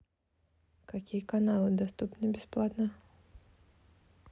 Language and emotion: Russian, neutral